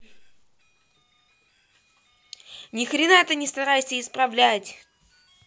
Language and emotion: Russian, angry